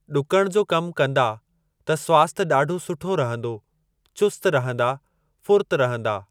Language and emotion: Sindhi, neutral